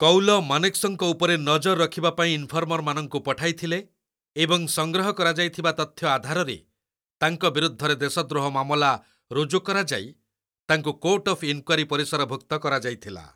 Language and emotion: Odia, neutral